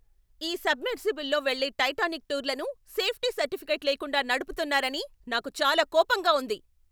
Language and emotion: Telugu, angry